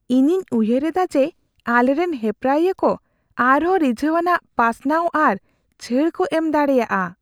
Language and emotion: Santali, fearful